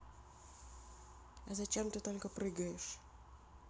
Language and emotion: Russian, neutral